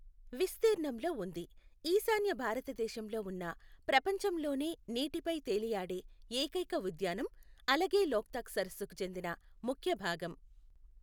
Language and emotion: Telugu, neutral